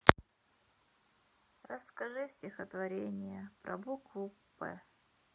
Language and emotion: Russian, sad